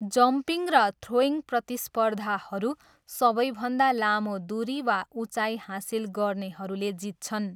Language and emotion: Nepali, neutral